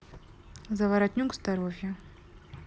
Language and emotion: Russian, neutral